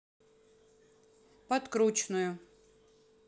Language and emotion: Russian, neutral